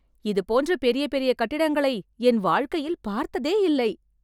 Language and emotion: Tamil, happy